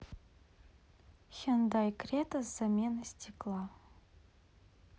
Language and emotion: Russian, neutral